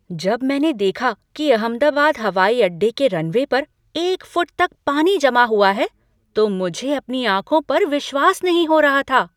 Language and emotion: Hindi, surprised